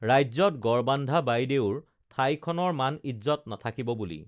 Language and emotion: Assamese, neutral